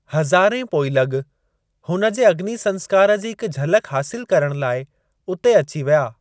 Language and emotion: Sindhi, neutral